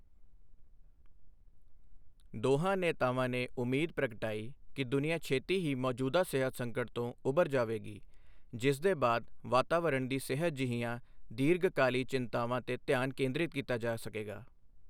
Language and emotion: Punjabi, neutral